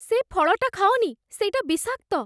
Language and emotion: Odia, fearful